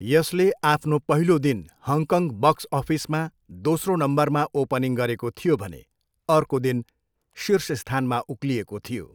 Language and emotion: Nepali, neutral